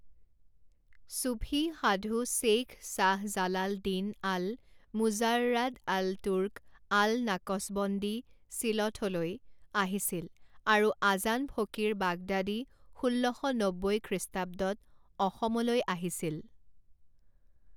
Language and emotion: Assamese, neutral